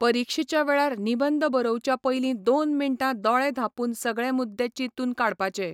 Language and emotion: Goan Konkani, neutral